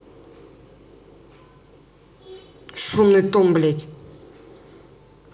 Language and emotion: Russian, angry